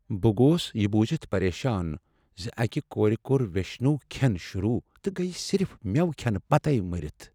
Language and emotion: Kashmiri, sad